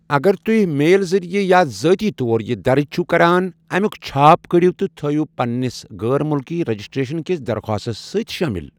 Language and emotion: Kashmiri, neutral